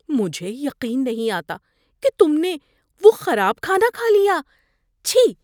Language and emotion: Urdu, disgusted